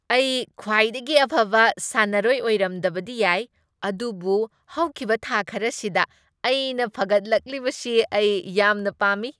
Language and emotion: Manipuri, happy